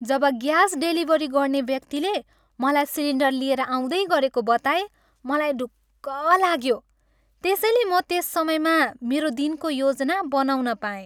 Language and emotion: Nepali, happy